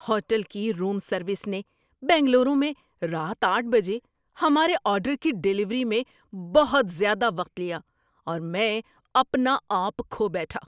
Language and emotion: Urdu, angry